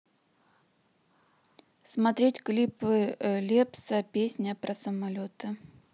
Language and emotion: Russian, neutral